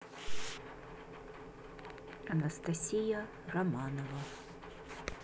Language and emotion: Russian, neutral